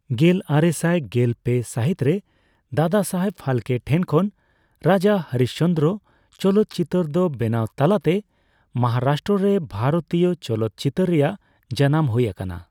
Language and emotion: Santali, neutral